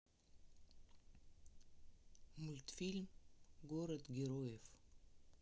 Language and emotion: Russian, neutral